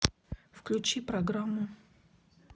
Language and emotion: Russian, neutral